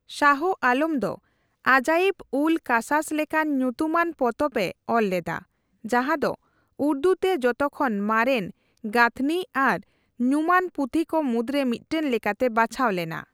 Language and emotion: Santali, neutral